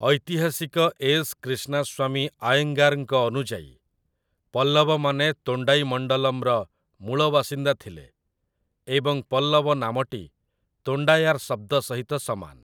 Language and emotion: Odia, neutral